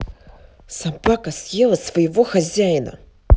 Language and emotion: Russian, angry